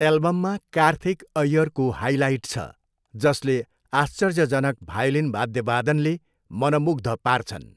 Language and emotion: Nepali, neutral